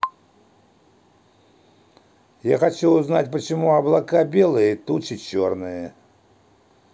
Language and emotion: Russian, neutral